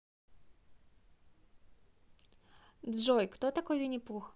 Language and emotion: Russian, neutral